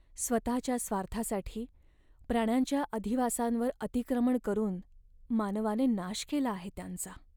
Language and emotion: Marathi, sad